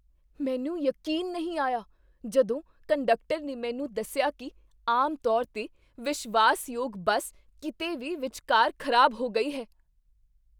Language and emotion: Punjabi, surprised